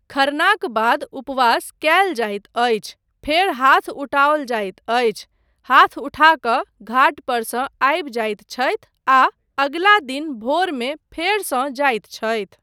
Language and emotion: Maithili, neutral